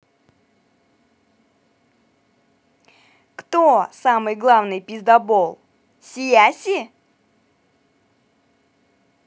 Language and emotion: Russian, positive